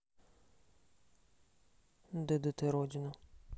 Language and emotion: Russian, neutral